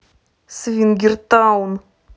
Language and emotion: Russian, angry